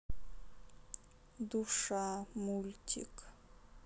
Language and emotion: Russian, sad